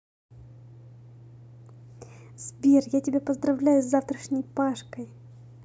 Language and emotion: Russian, positive